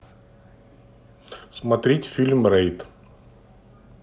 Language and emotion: Russian, neutral